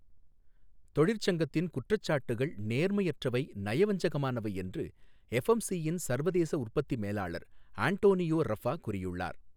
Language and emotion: Tamil, neutral